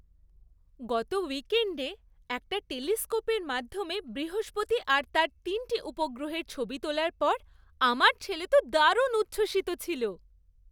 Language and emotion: Bengali, happy